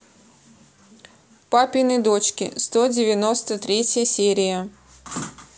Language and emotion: Russian, neutral